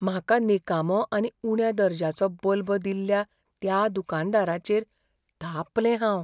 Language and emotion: Goan Konkani, fearful